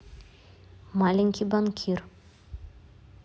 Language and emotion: Russian, neutral